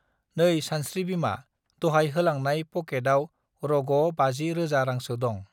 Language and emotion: Bodo, neutral